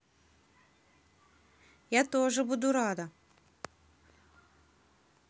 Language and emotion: Russian, positive